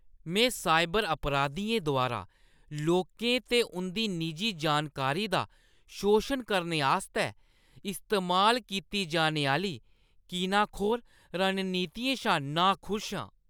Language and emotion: Dogri, disgusted